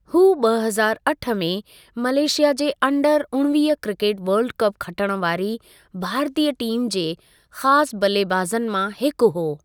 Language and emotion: Sindhi, neutral